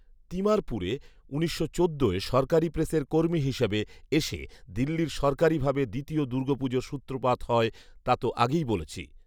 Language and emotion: Bengali, neutral